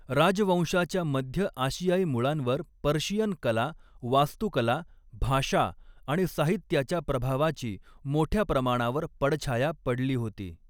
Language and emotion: Marathi, neutral